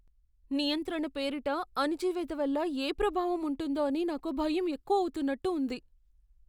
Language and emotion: Telugu, fearful